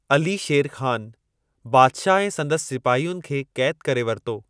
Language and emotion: Sindhi, neutral